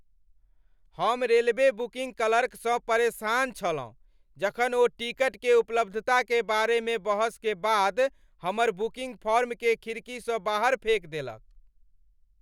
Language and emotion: Maithili, angry